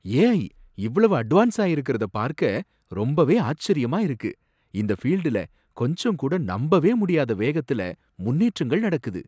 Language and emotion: Tamil, surprised